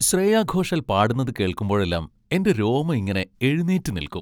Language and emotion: Malayalam, happy